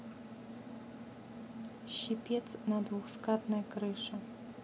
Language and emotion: Russian, neutral